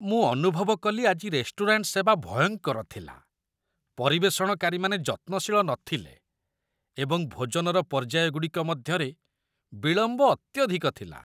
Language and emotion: Odia, disgusted